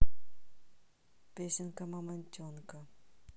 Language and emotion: Russian, neutral